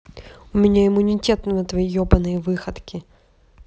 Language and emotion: Russian, angry